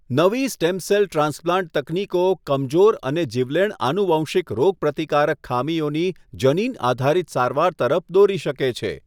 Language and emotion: Gujarati, neutral